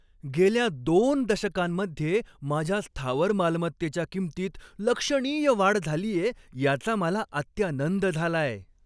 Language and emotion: Marathi, happy